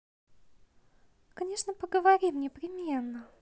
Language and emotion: Russian, positive